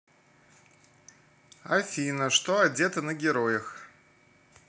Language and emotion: Russian, neutral